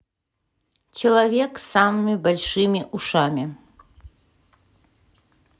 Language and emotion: Russian, neutral